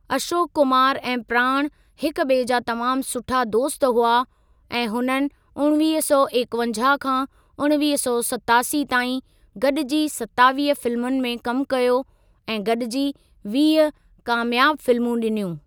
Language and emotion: Sindhi, neutral